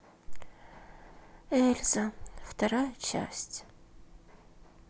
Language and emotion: Russian, sad